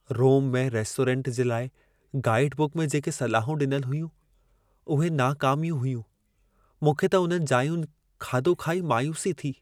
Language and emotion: Sindhi, sad